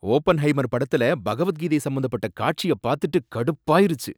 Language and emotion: Tamil, angry